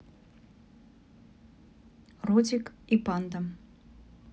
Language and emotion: Russian, neutral